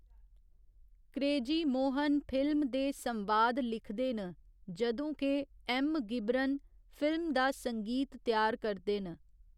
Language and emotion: Dogri, neutral